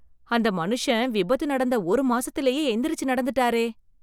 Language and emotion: Tamil, surprised